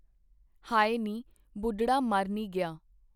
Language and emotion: Punjabi, neutral